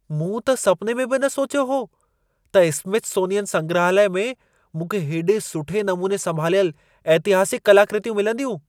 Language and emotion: Sindhi, surprised